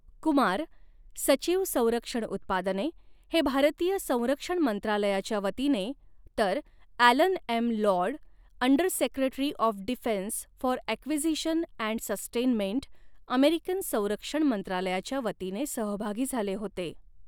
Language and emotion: Marathi, neutral